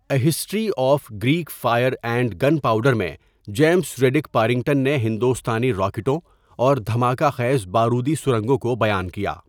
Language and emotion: Urdu, neutral